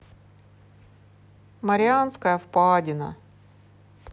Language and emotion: Russian, sad